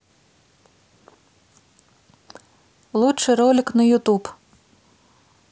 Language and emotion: Russian, neutral